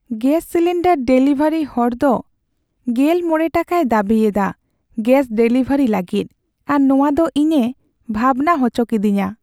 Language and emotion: Santali, sad